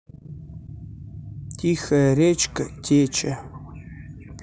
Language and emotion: Russian, neutral